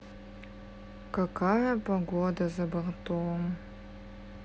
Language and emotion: Russian, sad